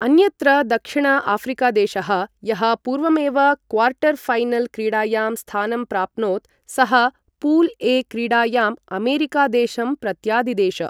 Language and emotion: Sanskrit, neutral